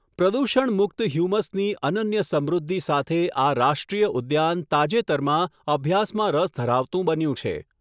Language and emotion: Gujarati, neutral